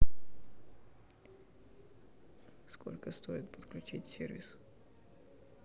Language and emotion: Russian, neutral